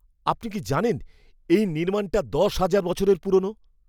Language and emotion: Bengali, surprised